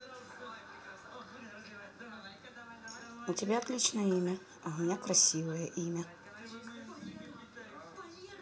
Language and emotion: Russian, neutral